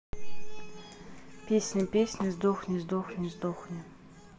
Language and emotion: Russian, neutral